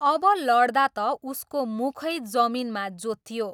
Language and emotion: Nepali, neutral